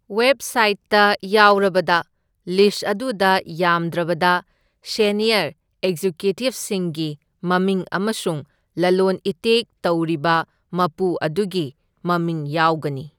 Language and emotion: Manipuri, neutral